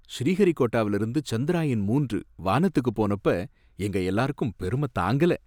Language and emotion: Tamil, happy